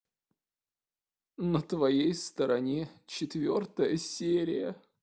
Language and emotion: Russian, sad